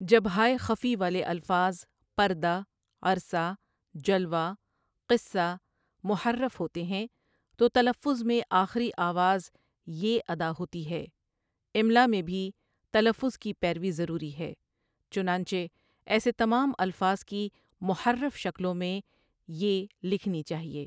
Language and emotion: Urdu, neutral